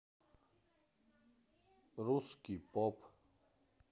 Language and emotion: Russian, neutral